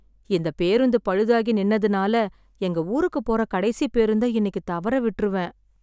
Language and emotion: Tamil, sad